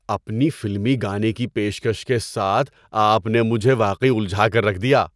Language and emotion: Urdu, surprised